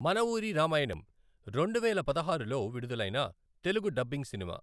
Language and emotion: Telugu, neutral